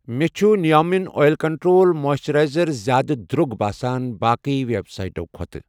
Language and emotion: Kashmiri, neutral